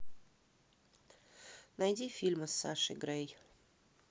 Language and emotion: Russian, neutral